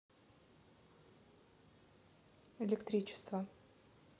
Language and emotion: Russian, neutral